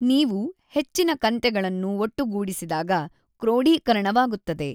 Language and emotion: Kannada, neutral